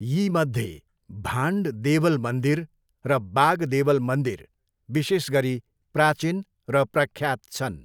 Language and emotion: Nepali, neutral